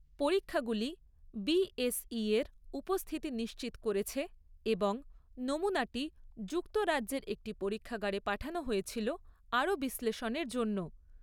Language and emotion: Bengali, neutral